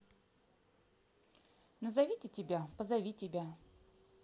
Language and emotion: Russian, neutral